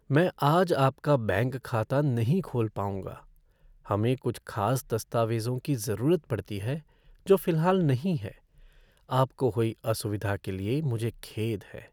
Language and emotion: Hindi, sad